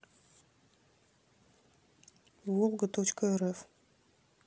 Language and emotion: Russian, neutral